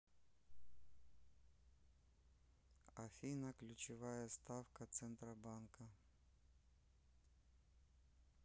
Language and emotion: Russian, neutral